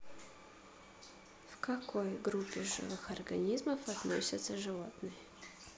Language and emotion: Russian, neutral